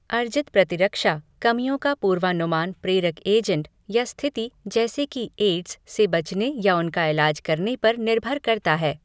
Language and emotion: Hindi, neutral